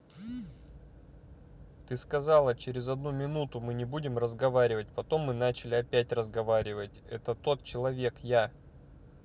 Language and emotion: Russian, angry